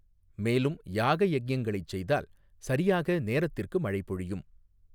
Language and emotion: Tamil, neutral